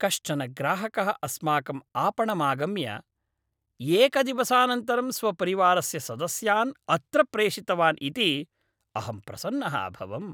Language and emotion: Sanskrit, happy